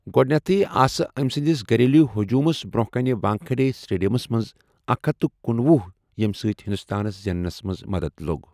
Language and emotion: Kashmiri, neutral